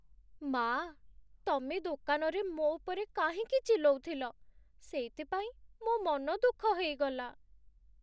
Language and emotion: Odia, sad